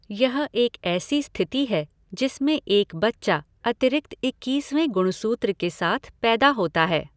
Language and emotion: Hindi, neutral